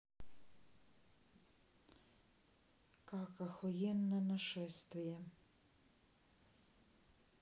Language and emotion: Russian, neutral